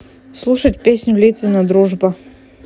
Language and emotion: Russian, neutral